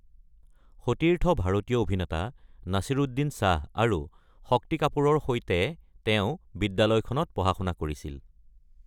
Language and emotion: Assamese, neutral